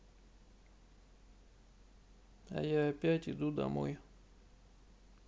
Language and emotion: Russian, sad